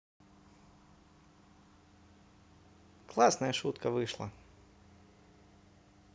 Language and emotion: Russian, positive